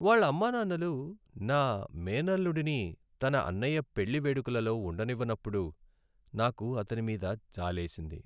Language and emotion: Telugu, sad